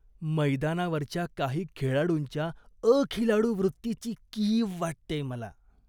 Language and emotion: Marathi, disgusted